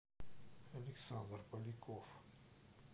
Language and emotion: Russian, neutral